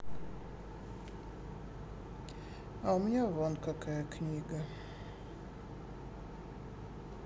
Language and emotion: Russian, sad